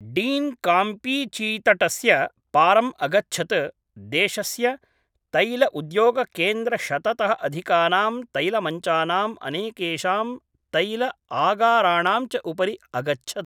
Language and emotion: Sanskrit, neutral